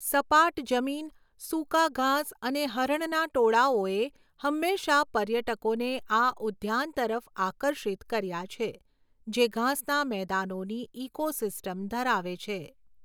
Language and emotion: Gujarati, neutral